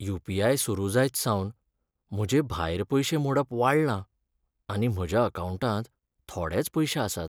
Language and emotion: Goan Konkani, sad